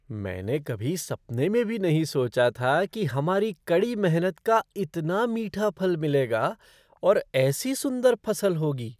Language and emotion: Hindi, surprised